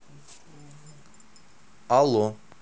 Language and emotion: Russian, neutral